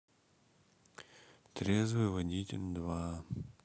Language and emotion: Russian, sad